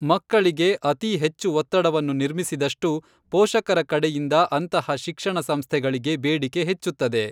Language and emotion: Kannada, neutral